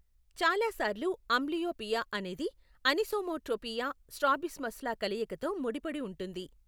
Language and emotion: Telugu, neutral